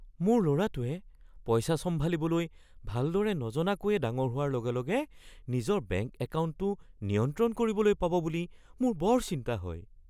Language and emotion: Assamese, fearful